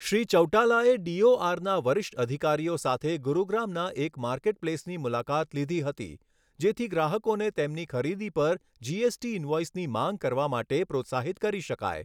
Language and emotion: Gujarati, neutral